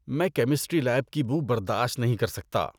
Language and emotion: Urdu, disgusted